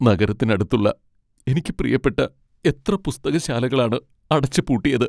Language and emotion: Malayalam, sad